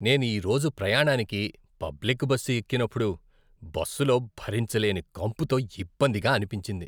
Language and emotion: Telugu, disgusted